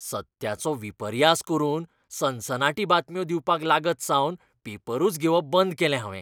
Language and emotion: Goan Konkani, disgusted